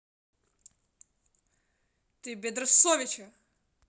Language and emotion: Russian, angry